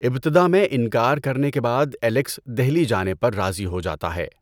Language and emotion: Urdu, neutral